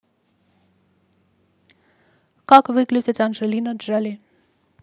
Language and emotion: Russian, neutral